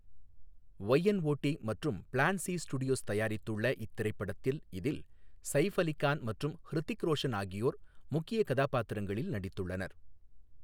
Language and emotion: Tamil, neutral